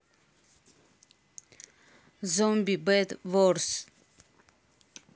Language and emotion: Russian, neutral